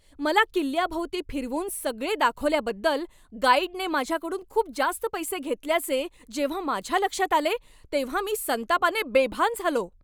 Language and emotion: Marathi, angry